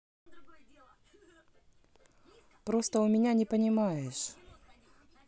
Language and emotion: Russian, neutral